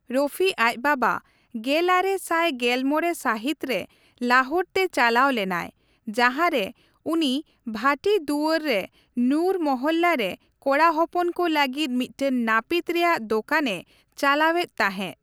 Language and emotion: Santali, neutral